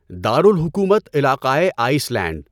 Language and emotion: Urdu, neutral